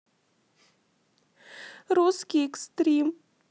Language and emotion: Russian, sad